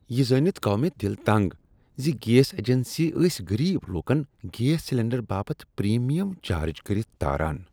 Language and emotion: Kashmiri, disgusted